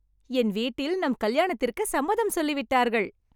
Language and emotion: Tamil, happy